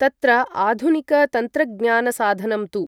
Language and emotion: Sanskrit, neutral